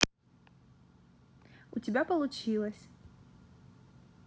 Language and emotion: Russian, positive